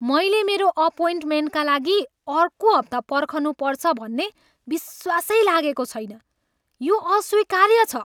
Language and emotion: Nepali, angry